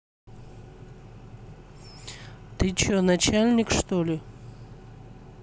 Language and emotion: Russian, neutral